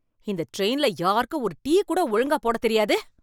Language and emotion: Tamil, angry